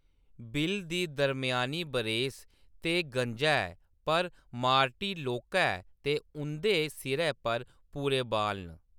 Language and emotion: Dogri, neutral